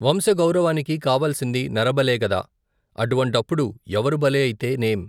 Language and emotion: Telugu, neutral